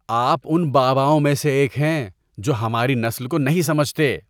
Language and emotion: Urdu, disgusted